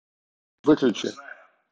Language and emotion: Russian, neutral